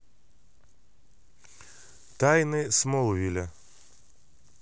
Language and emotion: Russian, neutral